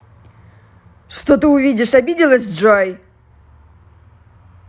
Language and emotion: Russian, angry